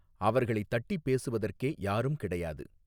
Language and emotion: Tamil, neutral